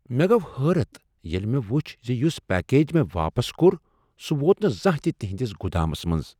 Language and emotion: Kashmiri, surprised